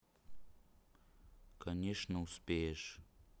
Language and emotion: Russian, neutral